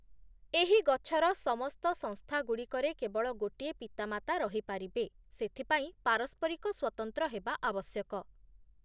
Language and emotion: Odia, neutral